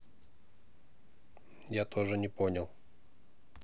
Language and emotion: Russian, neutral